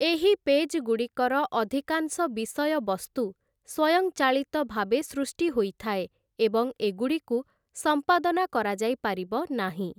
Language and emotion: Odia, neutral